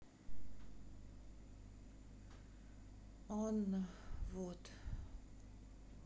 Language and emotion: Russian, sad